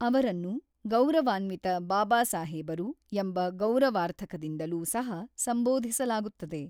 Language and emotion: Kannada, neutral